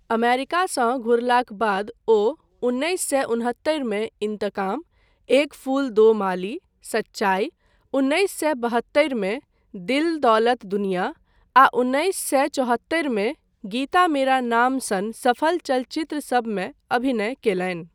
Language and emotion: Maithili, neutral